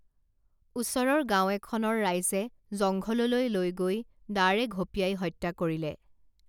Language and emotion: Assamese, neutral